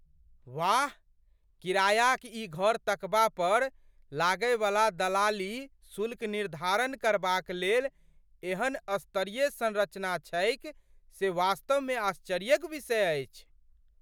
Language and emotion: Maithili, surprised